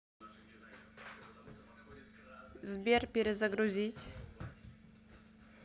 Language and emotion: Russian, neutral